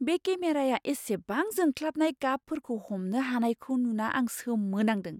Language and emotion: Bodo, surprised